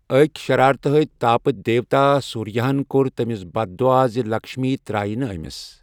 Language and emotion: Kashmiri, neutral